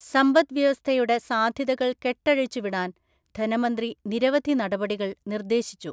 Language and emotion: Malayalam, neutral